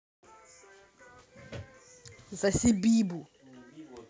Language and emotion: Russian, angry